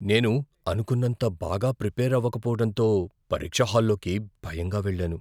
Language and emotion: Telugu, fearful